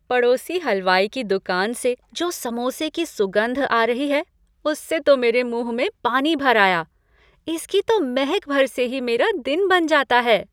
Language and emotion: Hindi, happy